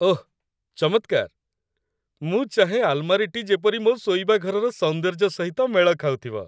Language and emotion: Odia, happy